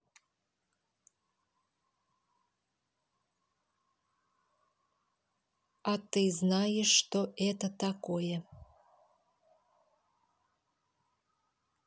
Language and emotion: Russian, neutral